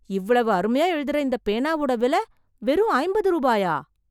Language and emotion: Tamil, surprised